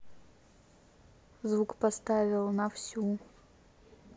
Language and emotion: Russian, neutral